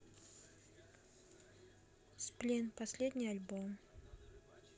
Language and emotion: Russian, neutral